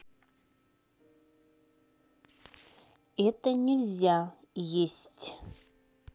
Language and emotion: Russian, neutral